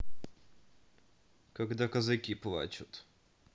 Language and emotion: Russian, neutral